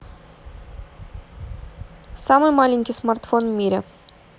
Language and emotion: Russian, neutral